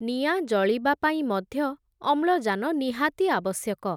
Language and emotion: Odia, neutral